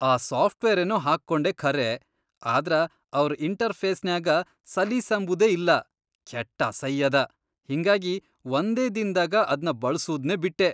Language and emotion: Kannada, disgusted